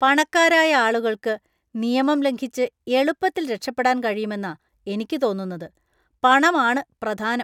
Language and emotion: Malayalam, disgusted